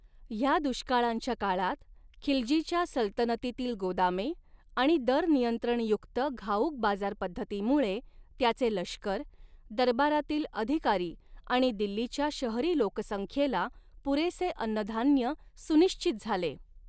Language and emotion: Marathi, neutral